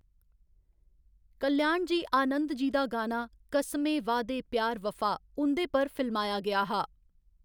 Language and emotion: Dogri, neutral